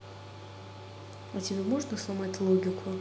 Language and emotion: Russian, neutral